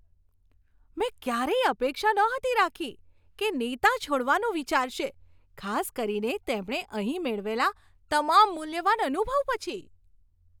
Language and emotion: Gujarati, surprised